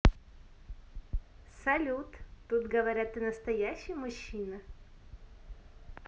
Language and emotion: Russian, positive